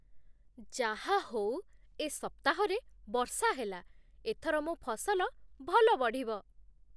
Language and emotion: Odia, happy